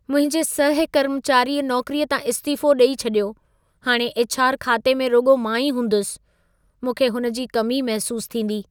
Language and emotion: Sindhi, sad